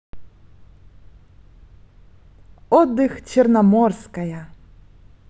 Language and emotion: Russian, positive